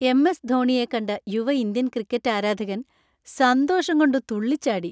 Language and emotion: Malayalam, happy